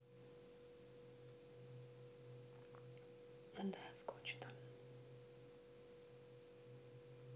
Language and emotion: Russian, sad